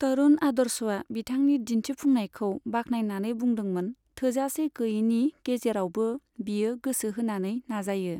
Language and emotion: Bodo, neutral